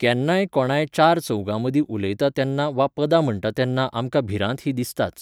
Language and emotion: Goan Konkani, neutral